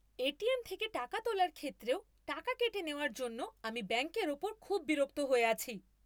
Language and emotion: Bengali, angry